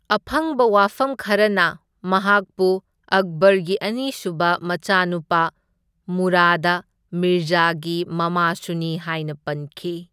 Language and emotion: Manipuri, neutral